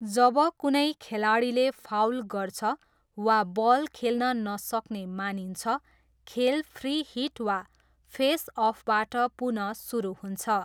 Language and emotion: Nepali, neutral